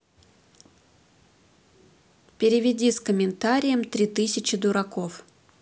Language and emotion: Russian, neutral